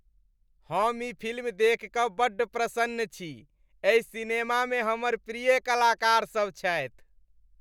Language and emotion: Maithili, happy